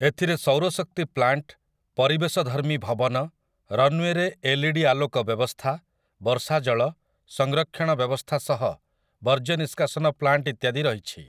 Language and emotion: Odia, neutral